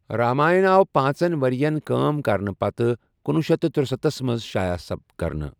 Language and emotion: Kashmiri, neutral